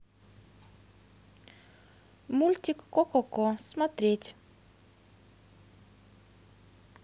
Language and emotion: Russian, positive